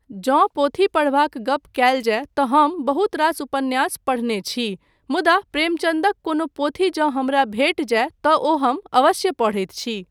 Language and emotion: Maithili, neutral